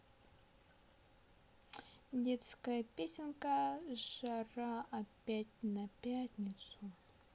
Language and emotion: Russian, neutral